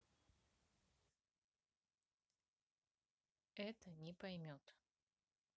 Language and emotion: Russian, neutral